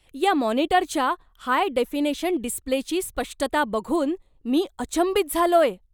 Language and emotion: Marathi, surprised